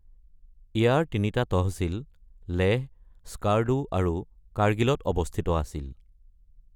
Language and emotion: Assamese, neutral